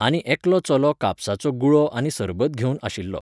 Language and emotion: Goan Konkani, neutral